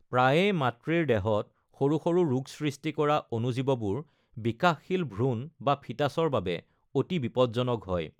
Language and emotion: Assamese, neutral